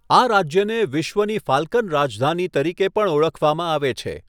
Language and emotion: Gujarati, neutral